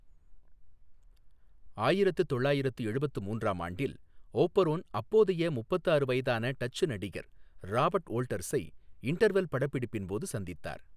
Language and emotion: Tamil, neutral